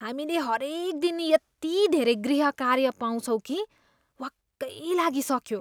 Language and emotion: Nepali, disgusted